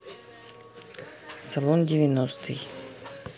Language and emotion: Russian, neutral